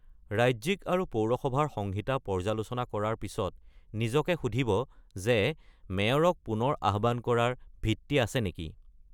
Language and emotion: Assamese, neutral